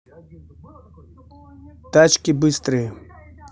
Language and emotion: Russian, neutral